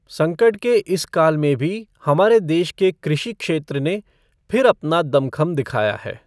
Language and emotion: Hindi, neutral